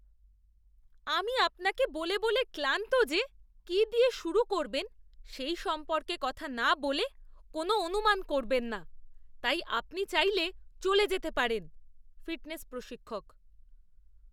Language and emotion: Bengali, disgusted